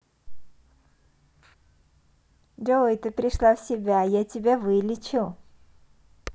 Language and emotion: Russian, positive